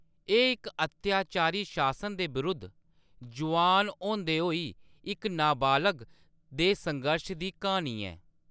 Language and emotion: Dogri, neutral